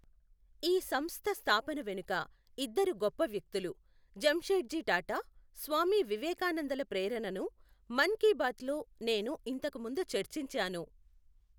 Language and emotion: Telugu, neutral